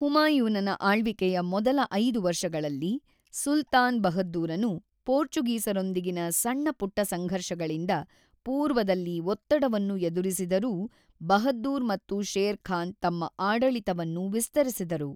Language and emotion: Kannada, neutral